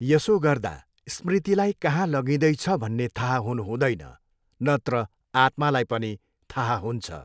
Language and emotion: Nepali, neutral